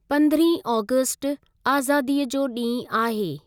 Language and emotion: Sindhi, neutral